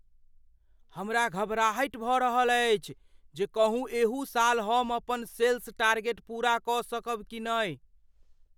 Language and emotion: Maithili, fearful